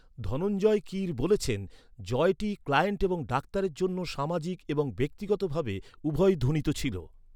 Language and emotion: Bengali, neutral